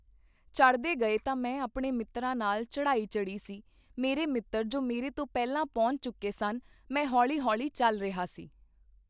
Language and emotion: Punjabi, neutral